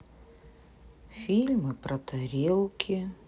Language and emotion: Russian, sad